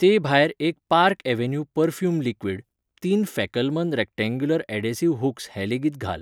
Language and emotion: Goan Konkani, neutral